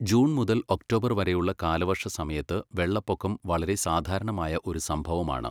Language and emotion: Malayalam, neutral